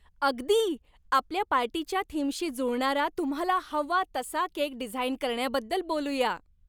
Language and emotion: Marathi, happy